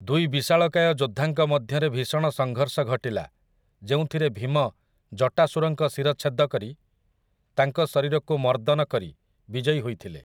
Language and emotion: Odia, neutral